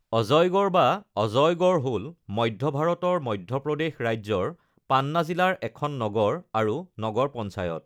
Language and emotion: Assamese, neutral